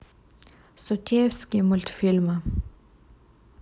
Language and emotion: Russian, neutral